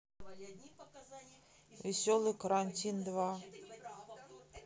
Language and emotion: Russian, neutral